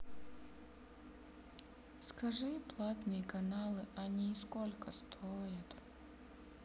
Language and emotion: Russian, sad